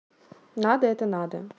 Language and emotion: Russian, neutral